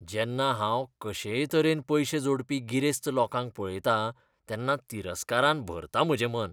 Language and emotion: Goan Konkani, disgusted